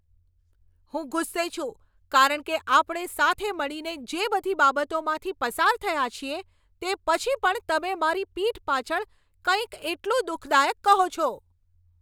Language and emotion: Gujarati, angry